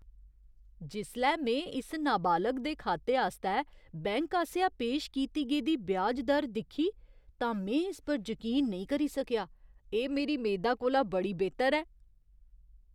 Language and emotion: Dogri, surprised